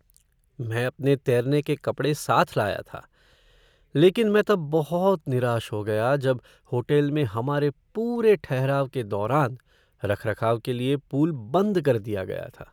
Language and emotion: Hindi, sad